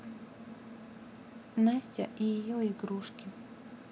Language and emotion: Russian, neutral